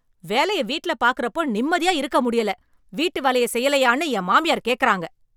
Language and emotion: Tamil, angry